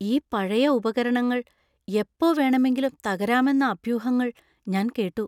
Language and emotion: Malayalam, fearful